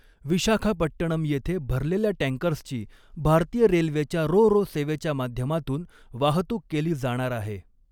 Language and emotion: Marathi, neutral